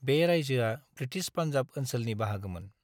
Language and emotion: Bodo, neutral